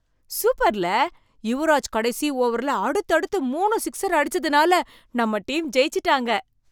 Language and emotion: Tamil, surprised